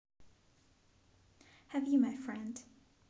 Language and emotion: Russian, positive